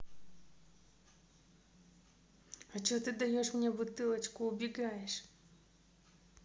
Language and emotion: Russian, neutral